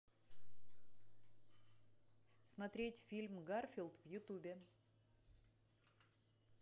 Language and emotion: Russian, neutral